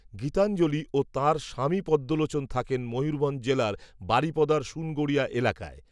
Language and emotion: Bengali, neutral